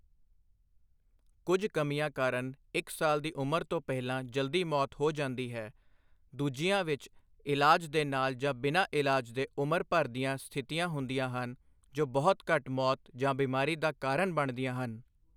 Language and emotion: Punjabi, neutral